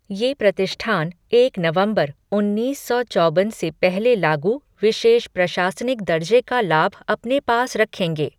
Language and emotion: Hindi, neutral